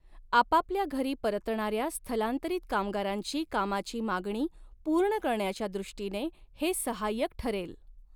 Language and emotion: Marathi, neutral